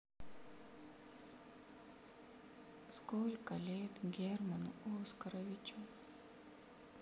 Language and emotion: Russian, sad